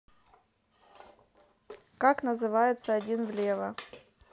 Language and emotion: Russian, neutral